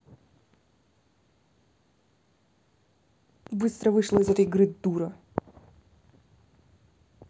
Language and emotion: Russian, angry